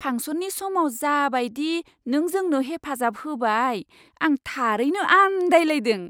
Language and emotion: Bodo, surprised